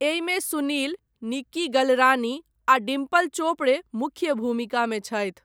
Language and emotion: Maithili, neutral